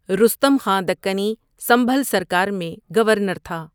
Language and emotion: Urdu, neutral